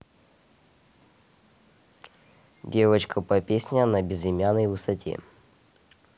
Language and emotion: Russian, neutral